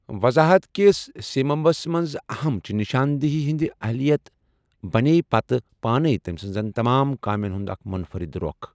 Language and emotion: Kashmiri, neutral